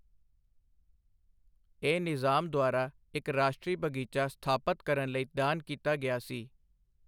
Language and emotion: Punjabi, neutral